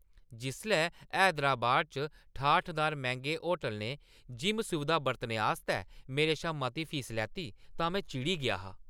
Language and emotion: Dogri, angry